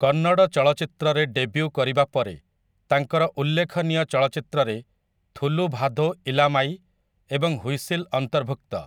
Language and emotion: Odia, neutral